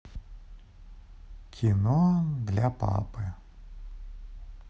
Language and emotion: Russian, sad